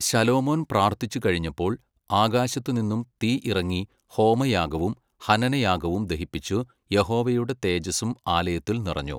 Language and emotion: Malayalam, neutral